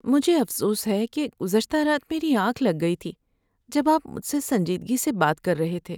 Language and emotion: Urdu, sad